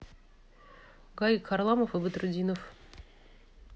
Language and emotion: Russian, neutral